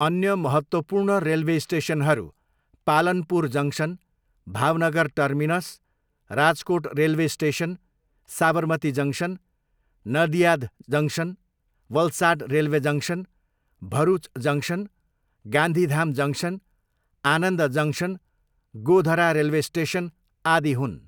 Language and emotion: Nepali, neutral